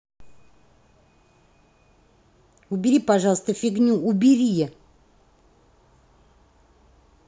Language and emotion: Russian, angry